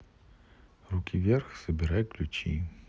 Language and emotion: Russian, neutral